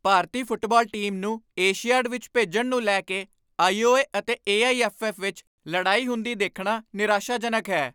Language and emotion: Punjabi, angry